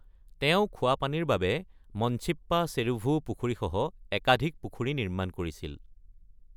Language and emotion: Assamese, neutral